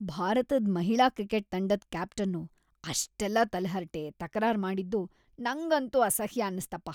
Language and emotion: Kannada, disgusted